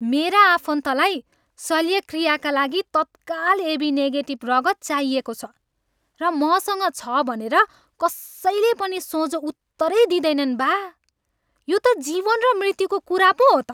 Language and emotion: Nepali, angry